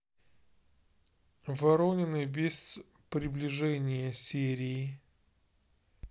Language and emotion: Russian, neutral